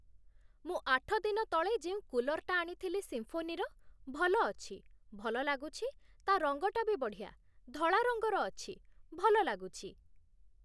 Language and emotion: Odia, neutral